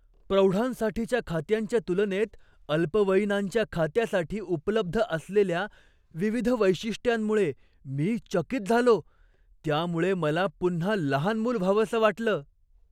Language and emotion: Marathi, surprised